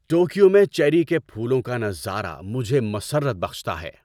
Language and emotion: Urdu, happy